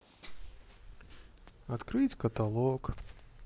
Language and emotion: Russian, sad